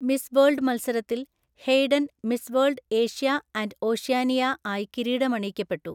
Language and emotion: Malayalam, neutral